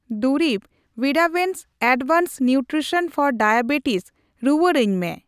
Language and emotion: Santali, neutral